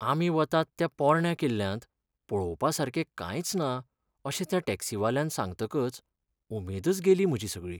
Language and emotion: Goan Konkani, sad